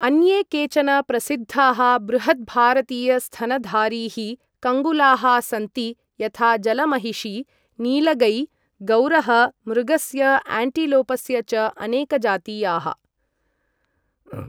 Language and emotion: Sanskrit, neutral